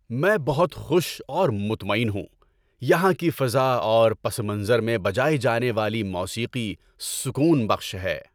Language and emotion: Urdu, happy